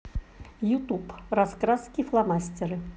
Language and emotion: Russian, neutral